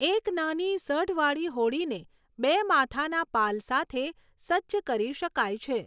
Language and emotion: Gujarati, neutral